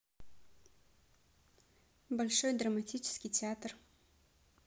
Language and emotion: Russian, neutral